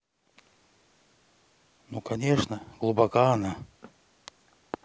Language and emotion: Russian, neutral